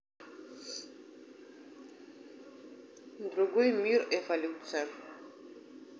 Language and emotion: Russian, neutral